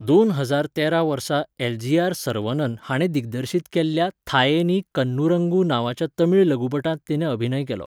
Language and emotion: Goan Konkani, neutral